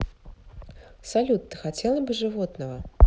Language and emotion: Russian, neutral